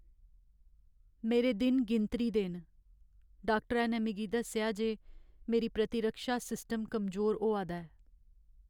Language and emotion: Dogri, sad